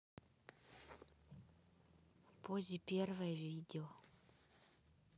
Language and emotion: Russian, neutral